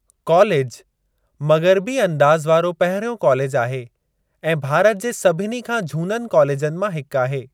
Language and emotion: Sindhi, neutral